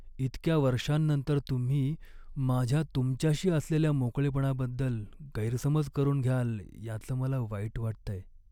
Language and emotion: Marathi, sad